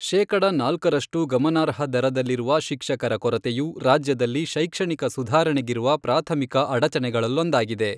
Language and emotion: Kannada, neutral